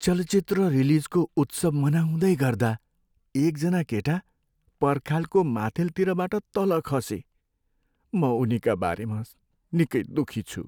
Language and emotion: Nepali, sad